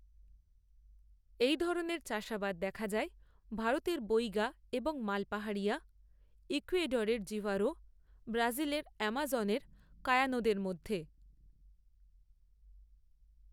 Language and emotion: Bengali, neutral